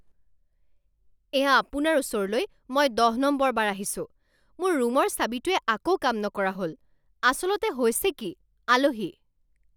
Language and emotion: Assamese, angry